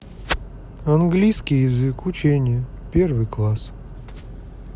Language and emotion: Russian, sad